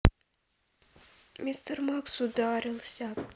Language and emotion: Russian, sad